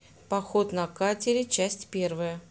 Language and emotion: Russian, neutral